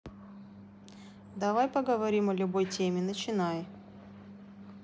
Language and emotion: Russian, neutral